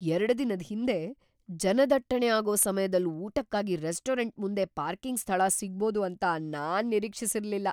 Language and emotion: Kannada, surprised